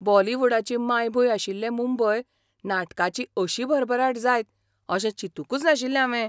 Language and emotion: Goan Konkani, surprised